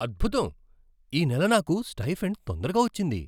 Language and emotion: Telugu, surprised